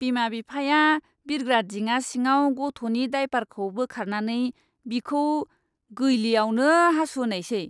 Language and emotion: Bodo, disgusted